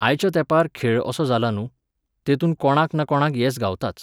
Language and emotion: Goan Konkani, neutral